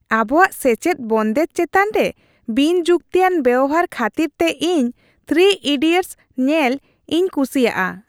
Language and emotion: Santali, happy